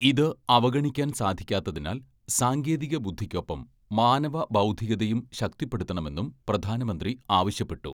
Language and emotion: Malayalam, neutral